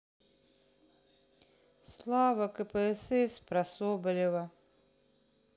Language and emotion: Russian, sad